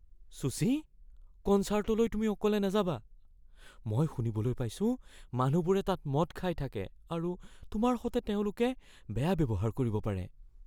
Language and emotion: Assamese, fearful